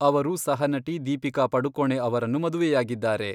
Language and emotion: Kannada, neutral